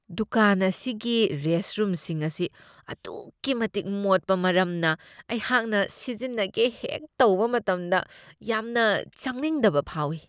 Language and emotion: Manipuri, disgusted